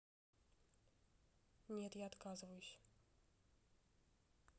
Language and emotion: Russian, neutral